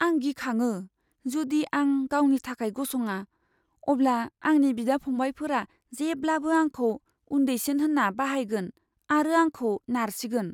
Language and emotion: Bodo, fearful